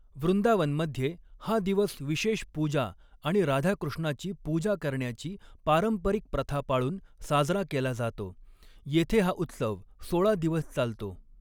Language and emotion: Marathi, neutral